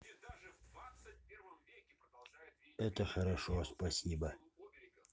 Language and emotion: Russian, neutral